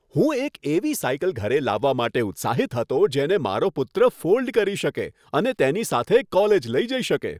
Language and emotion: Gujarati, happy